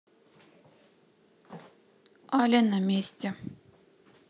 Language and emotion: Russian, neutral